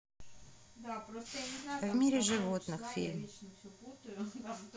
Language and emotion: Russian, neutral